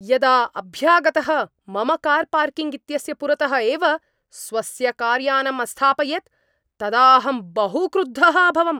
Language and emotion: Sanskrit, angry